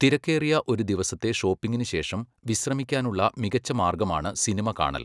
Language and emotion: Malayalam, neutral